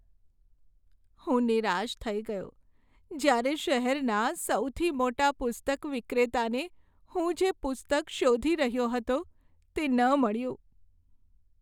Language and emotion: Gujarati, sad